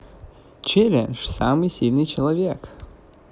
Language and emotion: Russian, positive